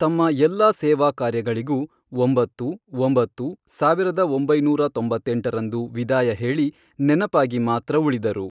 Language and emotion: Kannada, neutral